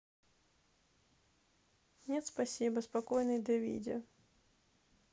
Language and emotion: Russian, neutral